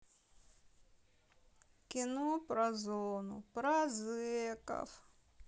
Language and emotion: Russian, sad